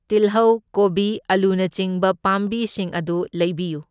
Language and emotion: Manipuri, neutral